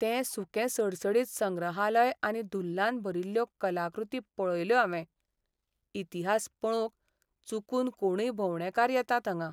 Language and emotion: Goan Konkani, sad